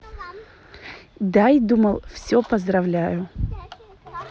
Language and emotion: Russian, neutral